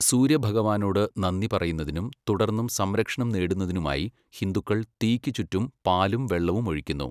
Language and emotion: Malayalam, neutral